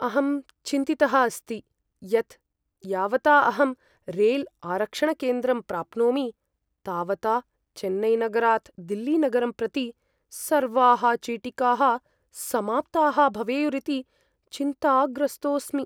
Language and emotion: Sanskrit, fearful